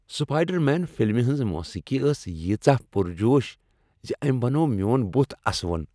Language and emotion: Kashmiri, happy